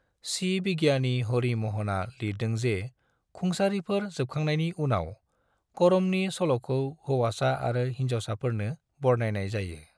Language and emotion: Bodo, neutral